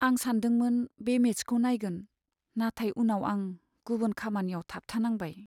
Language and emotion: Bodo, sad